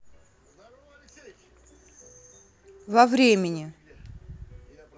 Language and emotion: Russian, neutral